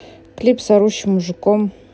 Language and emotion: Russian, neutral